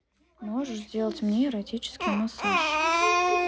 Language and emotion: Russian, neutral